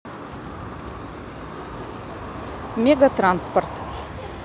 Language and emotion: Russian, neutral